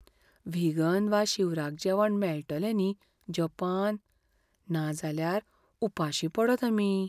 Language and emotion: Goan Konkani, fearful